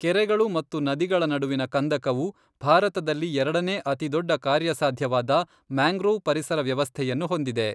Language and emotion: Kannada, neutral